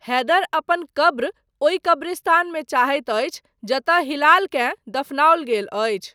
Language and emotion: Maithili, neutral